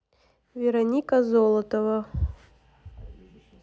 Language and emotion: Russian, neutral